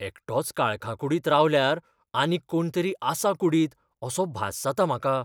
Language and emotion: Goan Konkani, fearful